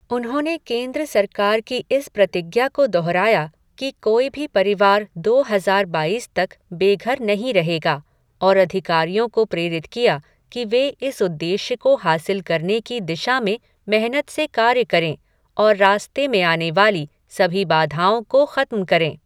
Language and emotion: Hindi, neutral